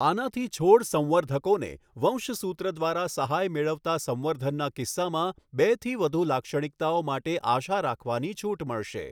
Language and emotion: Gujarati, neutral